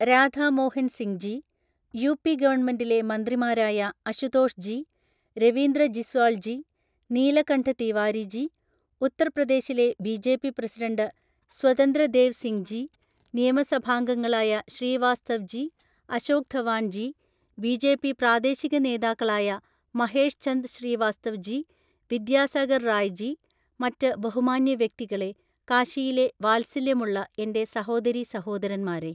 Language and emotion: Malayalam, neutral